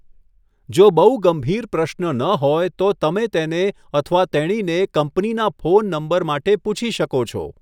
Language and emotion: Gujarati, neutral